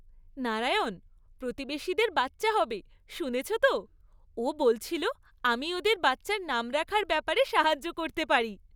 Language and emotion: Bengali, happy